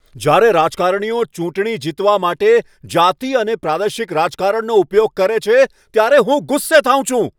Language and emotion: Gujarati, angry